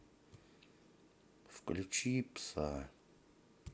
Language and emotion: Russian, sad